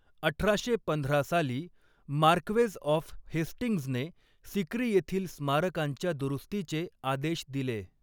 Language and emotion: Marathi, neutral